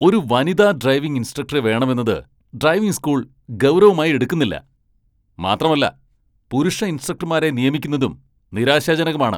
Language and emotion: Malayalam, angry